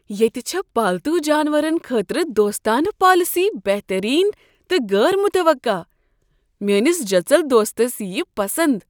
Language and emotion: Kashmiri, surprised